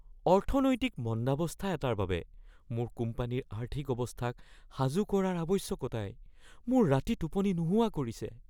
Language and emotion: Assamese, fearful